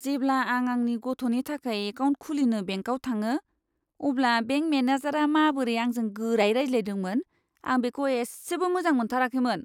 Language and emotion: Bodo, disgusted